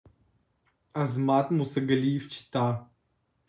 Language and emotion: Russian, neutral